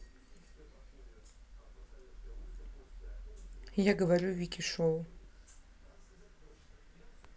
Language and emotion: Russian, neutral